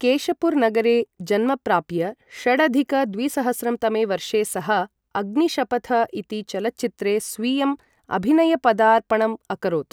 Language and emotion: Sanskrit, neutral